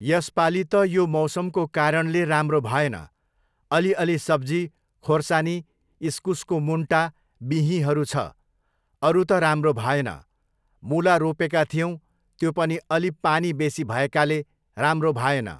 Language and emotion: Nepali, neutral